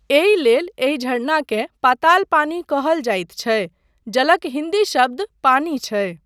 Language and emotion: Maithili, neutral